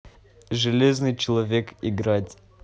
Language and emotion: Russian, neutral